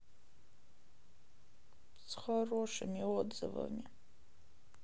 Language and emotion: Russian, sad